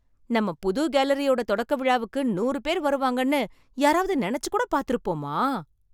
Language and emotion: Tamil, surprised